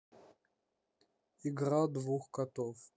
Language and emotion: Russian, neutral